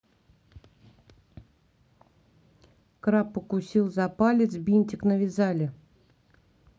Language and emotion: Russian, neutral